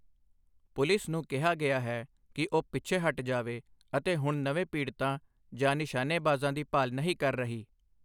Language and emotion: Punjabi, neutral